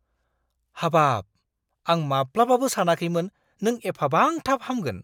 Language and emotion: Bodo, surprised